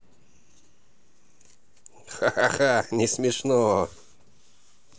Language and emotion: Russian, positive